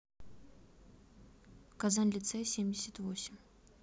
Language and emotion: Russian, neutral